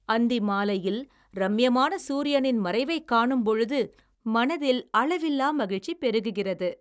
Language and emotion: Tamil, happy